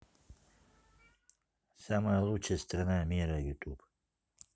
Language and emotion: Russian, neutral